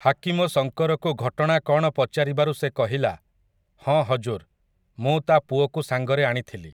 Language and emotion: Odia, neutral